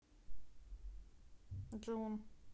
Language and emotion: Russian, neutral